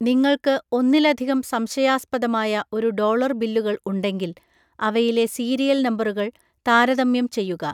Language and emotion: Malayalam, neutral